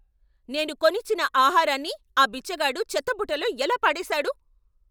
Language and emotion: Telugu, angry